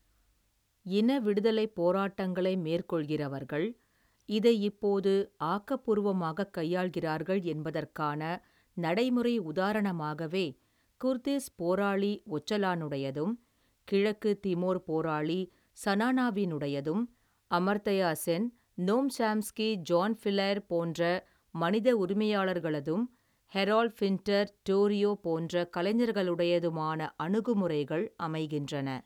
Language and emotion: Tamil, neutral